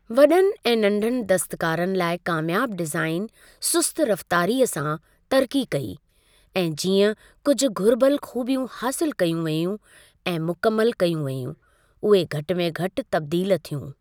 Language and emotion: Sindhi, neutral